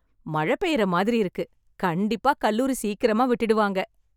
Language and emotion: Tamil, happy